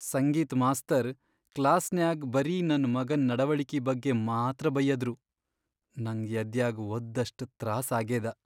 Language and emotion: Kannada, sad